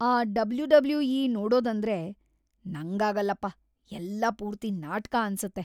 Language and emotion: Kannada, disgusted